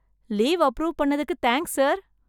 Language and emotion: Tamil, happy